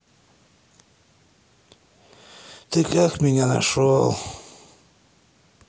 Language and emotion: Russian, sad